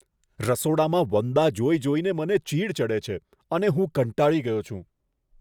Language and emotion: Gujarati, disgusted